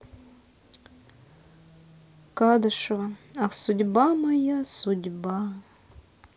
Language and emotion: Russian, sad